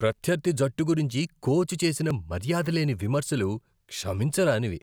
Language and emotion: Telugu, disgusted